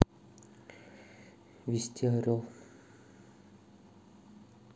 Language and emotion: Russian, neutral